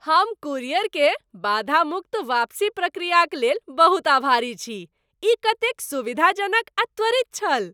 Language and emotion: Maithili, happy